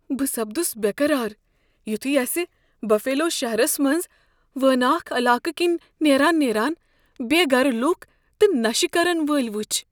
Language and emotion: Kashmiri, fearful